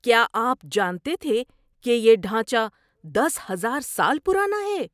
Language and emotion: Urdu, surprised